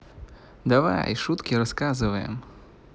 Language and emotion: Russian, positive